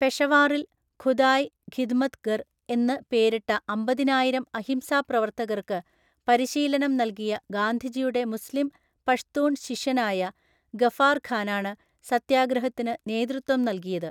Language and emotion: Malayalam, neutral